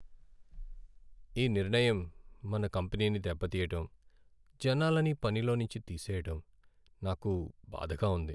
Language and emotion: Telugu, sad